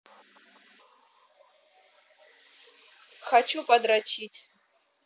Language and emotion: Russian, neutral